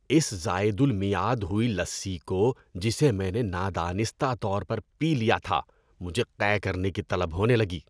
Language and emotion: Urdu, disgusted